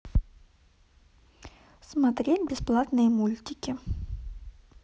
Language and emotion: Russian, neutral